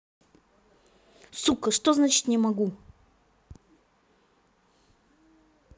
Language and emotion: Russian, angry